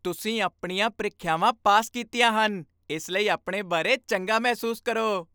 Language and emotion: Punjabi, happy